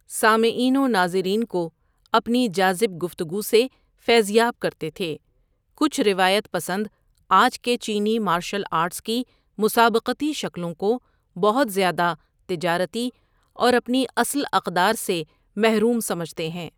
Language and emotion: Urdu, neutral